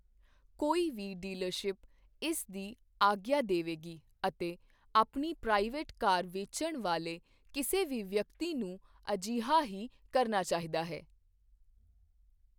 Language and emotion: Punjabi, neutral